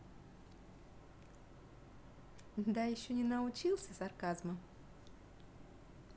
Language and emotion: Russian, positive